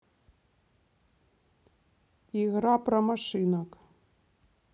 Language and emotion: Russian, neutral